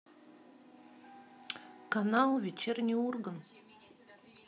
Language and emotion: Russian, neutral